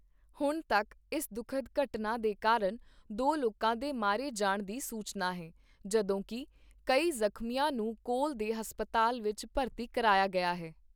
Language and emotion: Punjabi, neutral